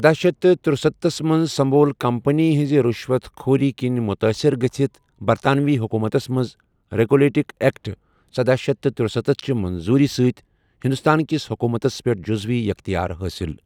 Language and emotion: Kashmiri, neutral